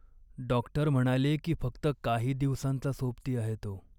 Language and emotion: Marathi, sad